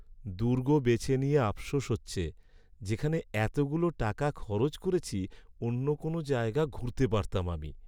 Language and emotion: Bengali, sad